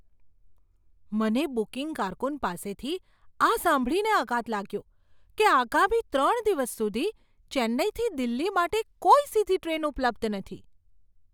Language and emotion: Gujarati, surprised